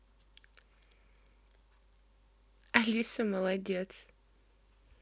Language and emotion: Russian, positive